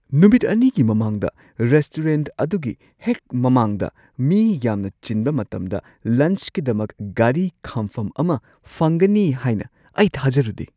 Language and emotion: Manipuri, surprised